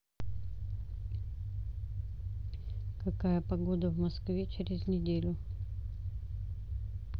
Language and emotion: Russian, neutral